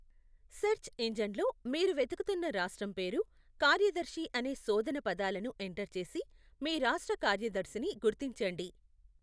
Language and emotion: Telugu, neutral